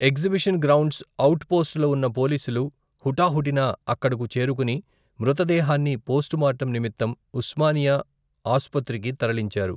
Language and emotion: Telugu, neutral